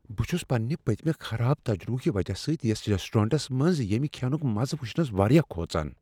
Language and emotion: Kashmiri, fearful